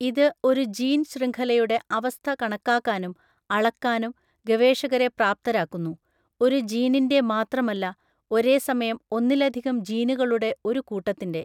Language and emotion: Malayalam, neutral